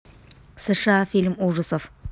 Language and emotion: Russian, neutral